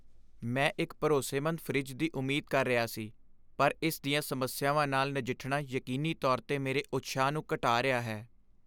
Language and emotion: Punjabi, sad